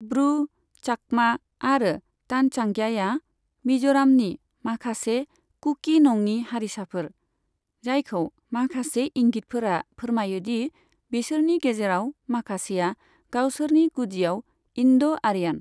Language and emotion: Bodo, neutral